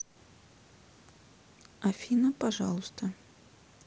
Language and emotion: Russian, neutral